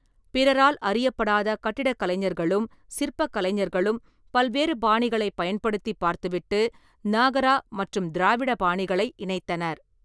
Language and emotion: Tamil, neutral